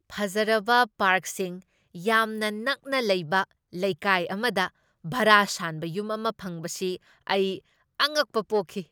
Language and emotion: Manipuri, surprised